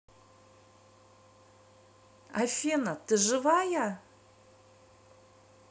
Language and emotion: Russian, neutral